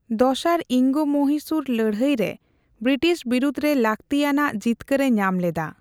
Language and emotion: Santali, neutral